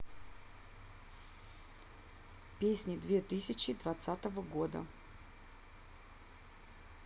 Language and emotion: Russian, neutral